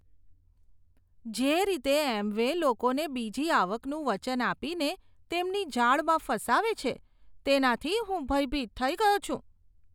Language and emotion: Gujarati, disgusted